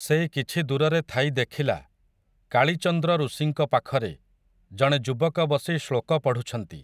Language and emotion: Odia, neutral